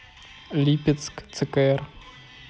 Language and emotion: Russian, neutral